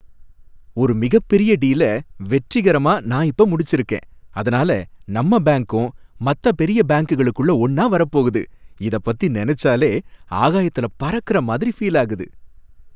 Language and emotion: Tamil, happy